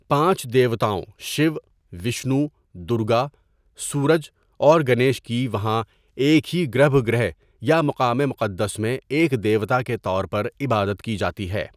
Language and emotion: Urdu, neutral